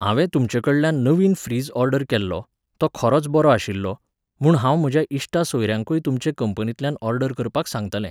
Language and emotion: Goan Konkani, neutral